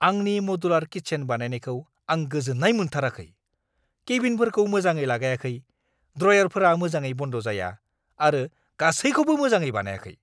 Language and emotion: Bodo, angry